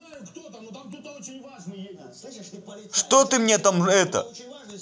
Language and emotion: Russian, angry